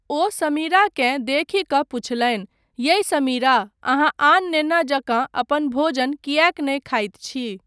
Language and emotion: Maithili, neutral